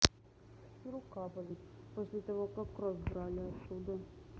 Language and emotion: Russian, sad